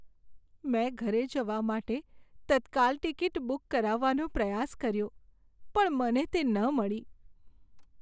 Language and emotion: Gujarati, sad